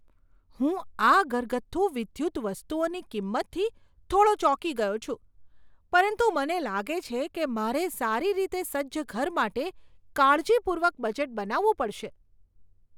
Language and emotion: Gujarati, surprised